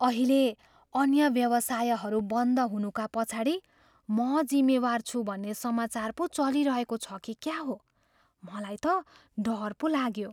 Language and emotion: Nepali, fearful